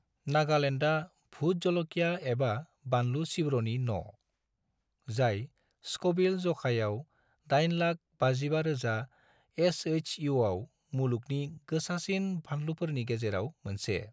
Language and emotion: Bodo, neutral